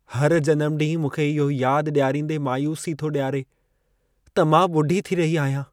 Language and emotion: Sindhi, sad